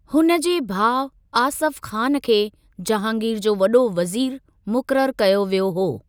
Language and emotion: Sindhi, neutral